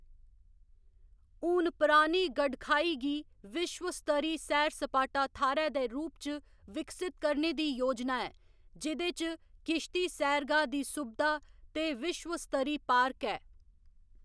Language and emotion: Dogri, neutral